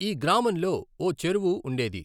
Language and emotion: Telugu, neutral